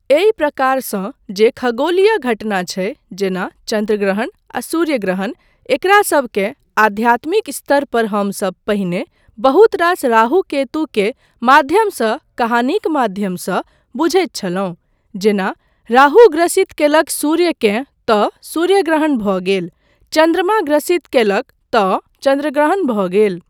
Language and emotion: Maithili, neutral